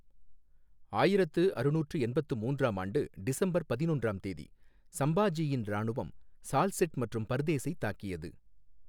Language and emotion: Tamil, neutral